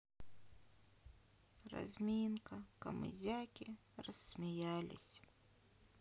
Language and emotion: Russian, sad